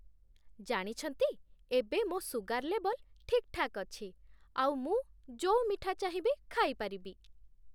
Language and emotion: Odia, happy